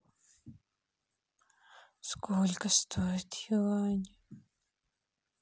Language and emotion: Russian, sad